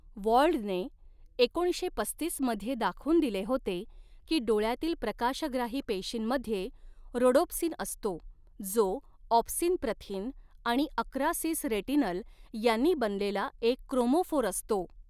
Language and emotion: Marathi, neutral